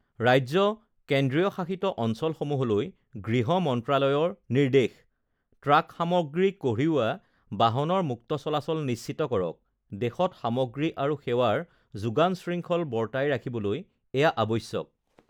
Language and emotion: Assamese, neutral